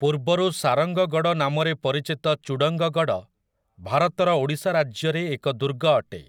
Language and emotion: Odia, neutral